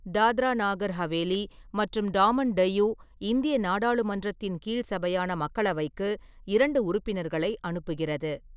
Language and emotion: Tamil, neutral